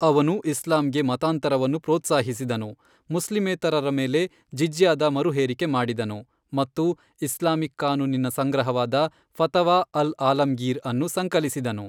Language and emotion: Kannada, neutral